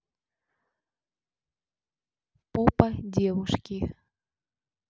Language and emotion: Russian, neutral